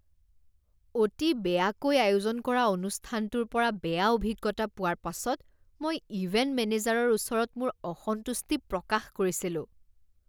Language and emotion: Assamese, disgusted